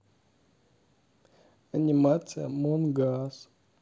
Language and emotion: Russian, sad